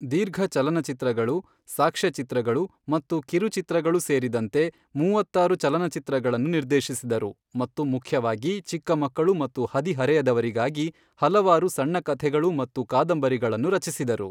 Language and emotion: Kannada, neutral